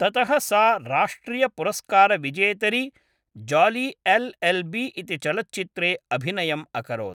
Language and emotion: Sanskrit, neutral